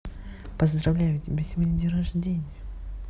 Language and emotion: Russian, neutral